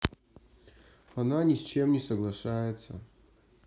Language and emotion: Russian, sad